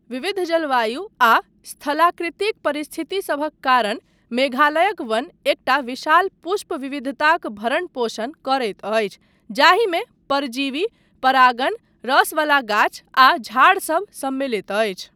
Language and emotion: Maithili, neutral